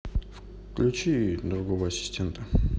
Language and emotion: Russian, neutral